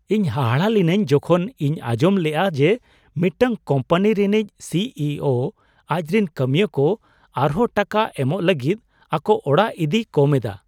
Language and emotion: Santali, surprised